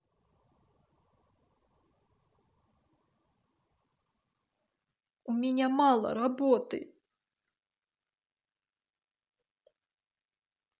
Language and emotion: Russian, sad